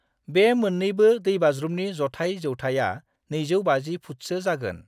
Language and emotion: Bodo, neutral